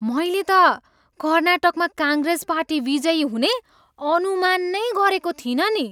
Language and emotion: Nepali, surprised